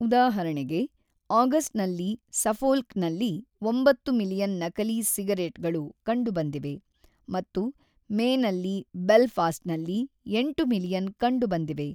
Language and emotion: Kannada, neutral